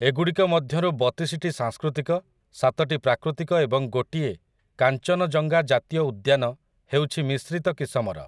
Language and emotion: Odia, neutral